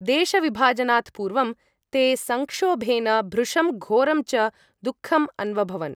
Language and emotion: Sanskrit, neutral